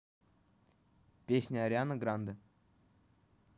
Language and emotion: Russian, neutral